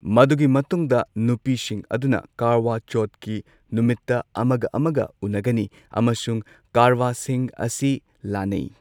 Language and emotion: Manipuri, neutral